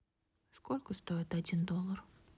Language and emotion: Russian, neutral